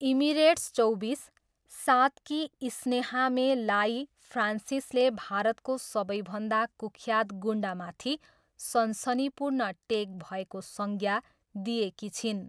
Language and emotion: Nepali, neutral